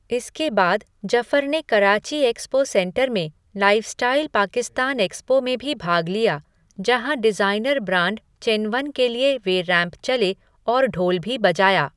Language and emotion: Hindi, neutral